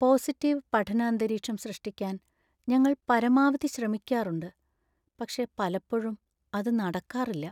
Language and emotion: Malayalam, sad